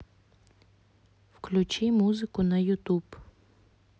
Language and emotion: Russian, neutral